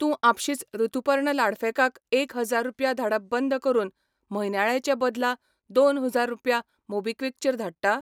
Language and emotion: Goan Konkani, neutral